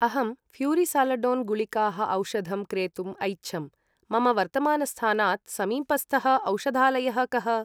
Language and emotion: Sanskrit, neutral